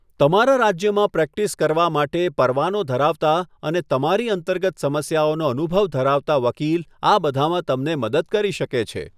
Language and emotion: Gujarati, neutral